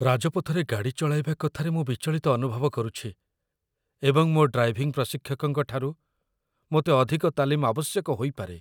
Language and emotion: Odia, fearful